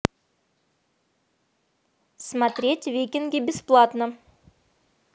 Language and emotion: Russian, neutral